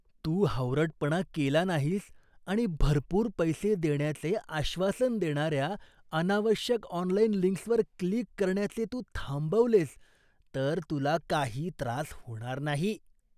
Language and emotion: Marathi, disgusted